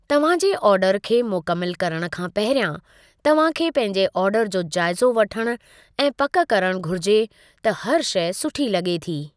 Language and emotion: Sindhi, neutral